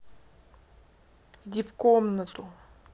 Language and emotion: Russian, angry